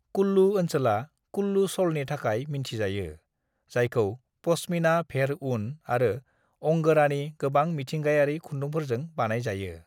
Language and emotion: Bodo, neutral